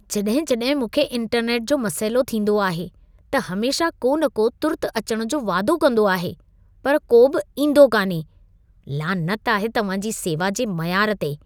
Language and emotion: Sindhi, disgusted